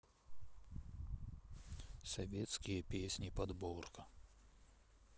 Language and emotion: Russian, sad